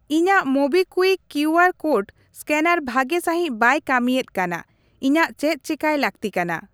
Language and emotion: Santali, neutral